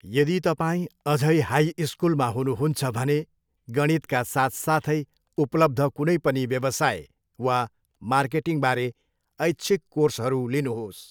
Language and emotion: Nepali, neutral